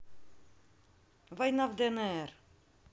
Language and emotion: Russian, neutral